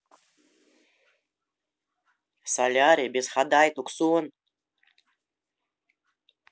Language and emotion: Russian, neutral